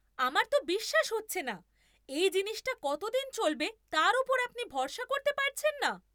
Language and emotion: Bengali, angry